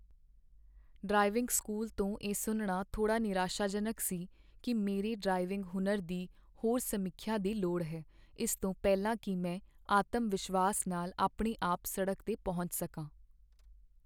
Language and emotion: Punjabi, sad